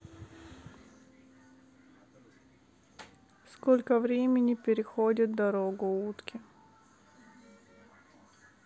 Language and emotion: Russian, neutral